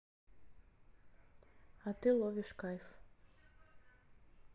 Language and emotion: Russian, neutral